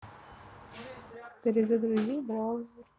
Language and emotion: Russian, neutral